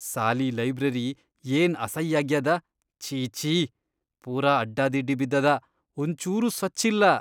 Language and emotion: Kannada, disgusted